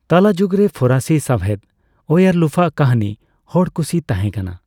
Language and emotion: Santali, neutral